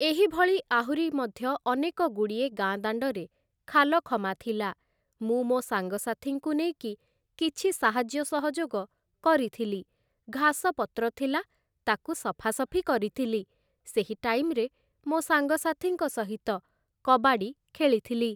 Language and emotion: Odia, neutral